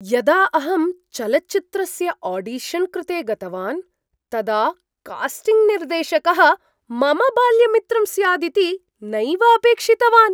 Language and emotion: Sanskrit, surprised